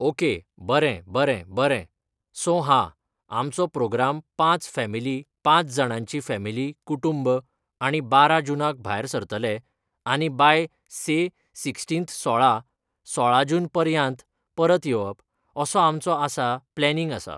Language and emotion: Goan Konkani, neutral